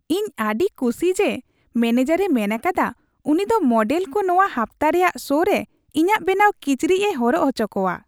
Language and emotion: Santali, happy